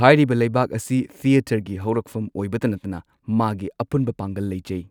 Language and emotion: Manipuri, neutral